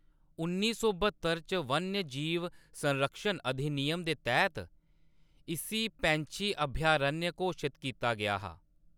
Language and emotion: Dogri, neutral